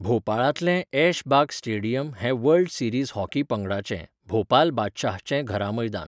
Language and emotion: Goan Konkani, neutral